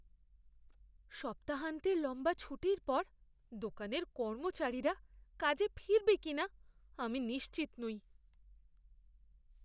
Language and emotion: Bengali, fearful